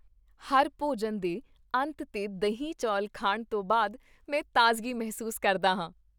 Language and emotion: Punjabi, happy